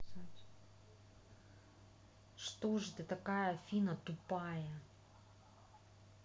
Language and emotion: Russian, neutral